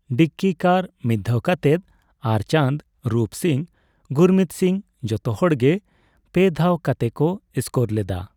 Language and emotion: Santali, neutral